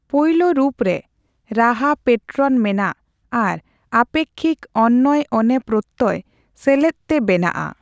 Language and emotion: Santali, neutral